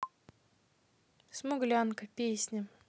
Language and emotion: Russian, neutral